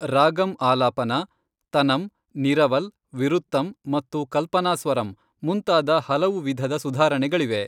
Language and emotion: Kannada, neutral